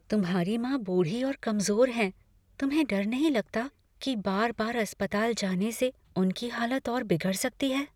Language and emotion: Hindi, fearful